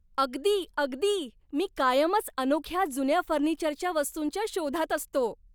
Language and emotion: Marathi, happy